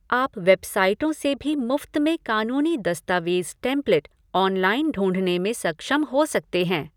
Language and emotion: Hindi, neutral